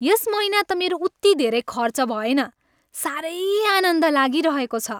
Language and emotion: Nepali, happy